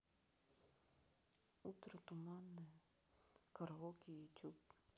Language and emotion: Russian, sad